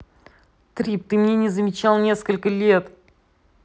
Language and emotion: Russian, angry